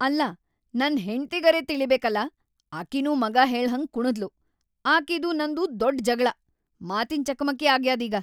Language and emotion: Kannada, angry